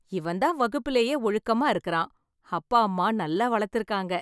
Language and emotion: Tamil, happy